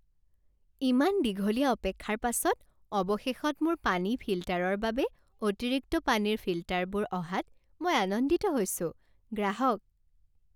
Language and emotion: Assamese, happy